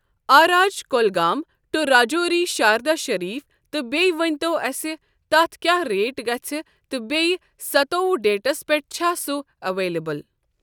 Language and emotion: Kashmiri, neutral